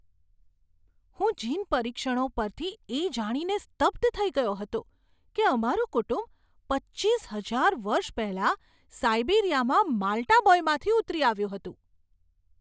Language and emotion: Gujarati, surprised